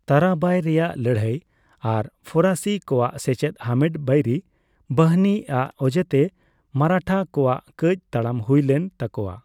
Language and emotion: Santali, neutral